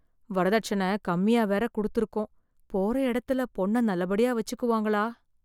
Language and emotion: Tamil, fearful